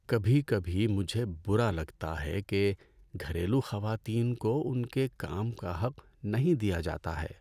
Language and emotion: Urdu, sad